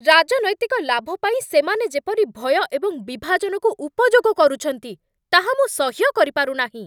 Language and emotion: Odia, angry